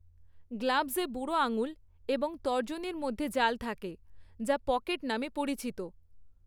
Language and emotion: Bengali, neutral